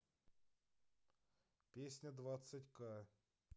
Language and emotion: Russian, neutral